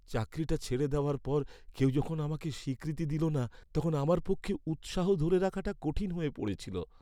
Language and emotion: Bengali, sad